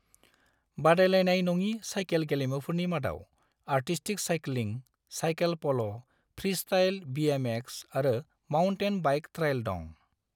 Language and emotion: Bodo, neutral